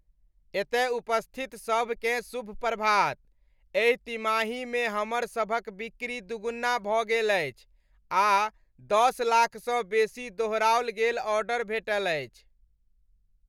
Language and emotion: Maithili, happy